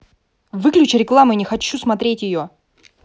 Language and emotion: Russian, angry